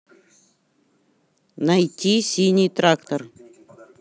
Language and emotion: Russian, neutral